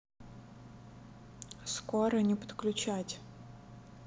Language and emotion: Russian, neutral